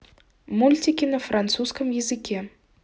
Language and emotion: Russian, neutral